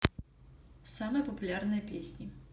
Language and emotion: Russian, neutral